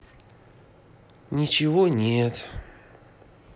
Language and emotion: Russian, sad